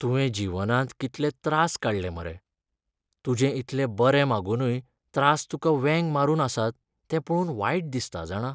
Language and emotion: Goan Konkani, sad